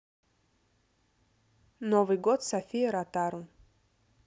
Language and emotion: Russian, neutral